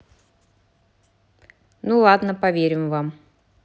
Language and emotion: Russian, neutral